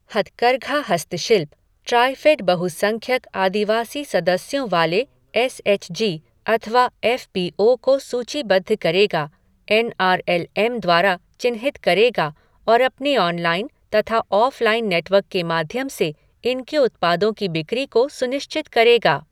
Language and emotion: Hindi, neutral